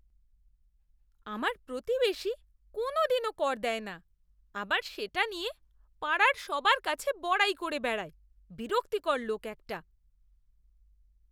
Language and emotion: Bengali, disgusted